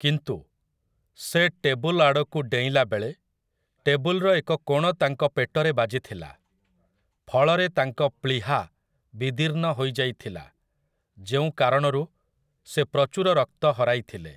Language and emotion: Odia, neutral